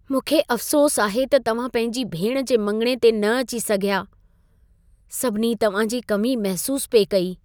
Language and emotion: Sindhi, sad